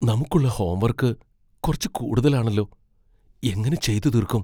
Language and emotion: Malayalam, fearful